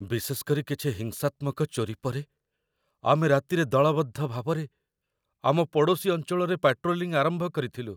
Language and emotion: Odia, fearful